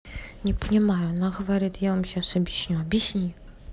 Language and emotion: Russian, neutral